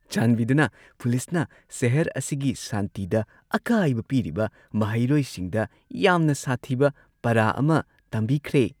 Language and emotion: Manipuri, happy